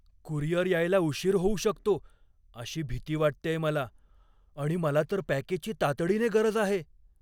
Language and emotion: Marathi, fearful